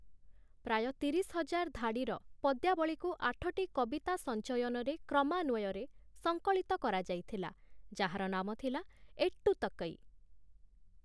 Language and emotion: Odia, neutral